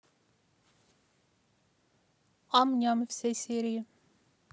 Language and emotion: Russian, neutral